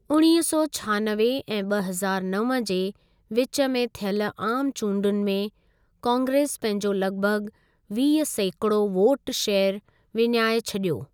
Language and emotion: Sindhi, neutral